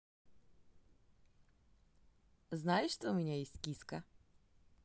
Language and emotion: Russian, positive